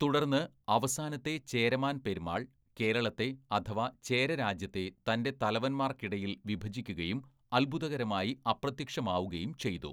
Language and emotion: Malayalam, neutral